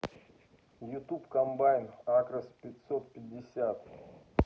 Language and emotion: Russian, neutral